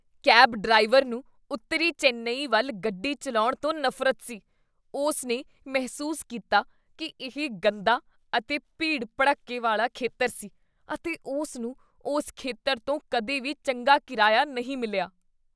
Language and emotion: Punjabi, disgusted